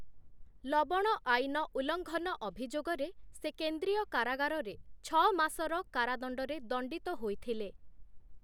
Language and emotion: Odia, neutral